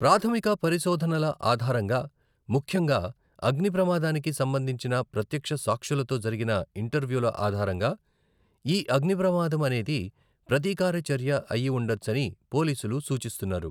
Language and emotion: Telugu, neutral